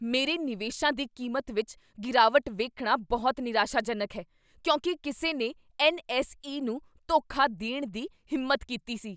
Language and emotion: Punjabi, angry